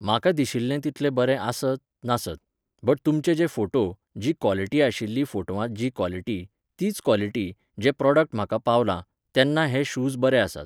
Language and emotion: Goan Konkani, neutral